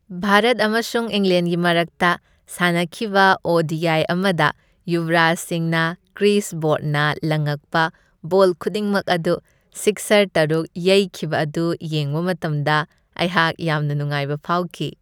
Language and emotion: Manipuri, happy